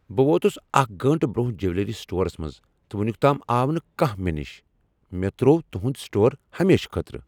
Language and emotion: Kashmiri, angry